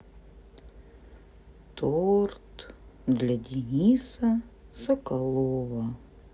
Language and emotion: Russian, sad